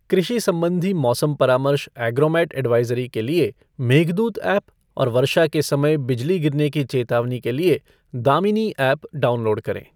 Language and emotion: Hindi, neutral